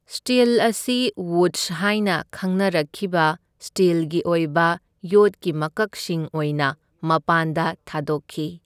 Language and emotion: Manipuri, neutral